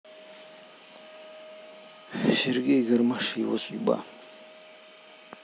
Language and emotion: Russian, sad